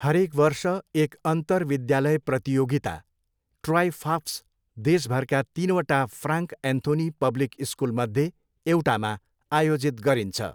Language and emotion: Nepali, neutral